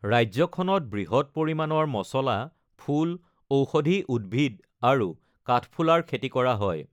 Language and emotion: Assamese, neutral